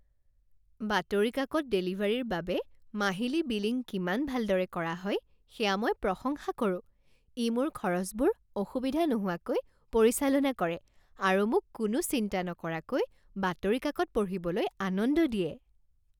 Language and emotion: Assamese, happy